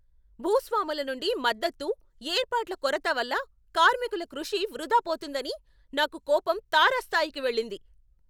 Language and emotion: Telugu, angry